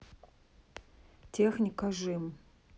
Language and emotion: Russian, neutral